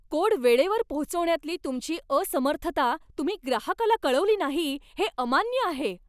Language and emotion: Marathi, angry